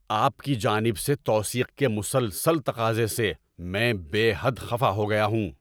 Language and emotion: Urdu, angry